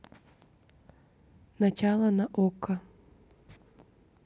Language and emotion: Russian, neutral